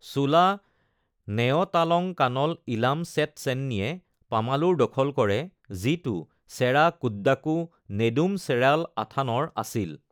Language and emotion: Assamese, neutral